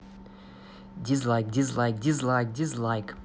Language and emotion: Russian, angry